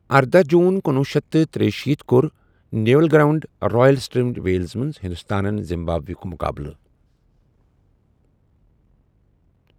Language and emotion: Kashmiri, neutral